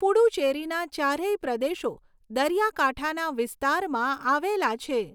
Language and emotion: Gujarati, neutral